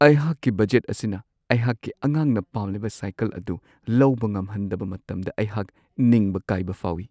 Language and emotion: Manipuri, sad